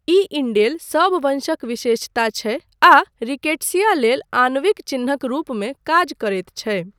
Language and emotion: Maithili, neutral